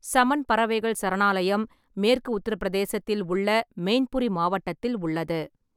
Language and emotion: Tamil, neutral